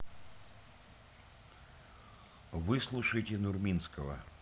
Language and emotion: Russian, neutral